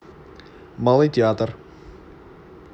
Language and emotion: Russian, neutral